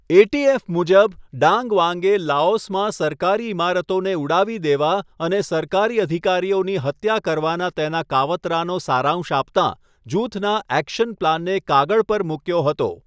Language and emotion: Gujarati, neutral